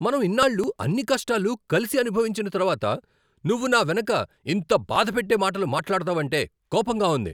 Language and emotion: Telugu, angry